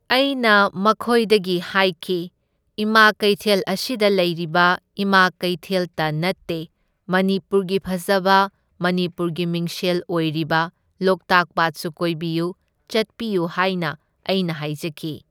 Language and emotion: Manipuri, neutral